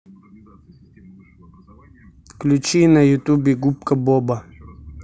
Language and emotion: Russian, neutral